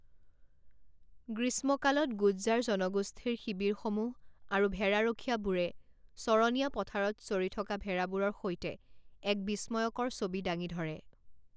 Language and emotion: Assamese, neutral